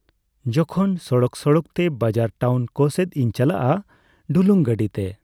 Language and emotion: Santali, neutral